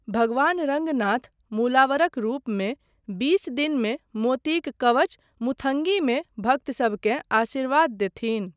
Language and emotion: Maithili, neutral